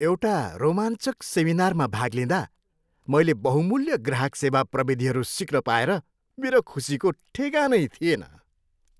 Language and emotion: Nepali, happy